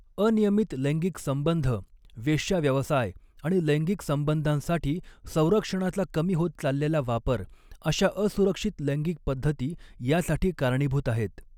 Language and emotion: Marathi, neutral